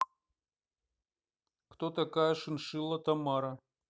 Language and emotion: Russian, neutral